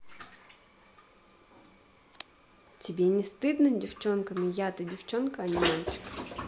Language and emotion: Russian, neutral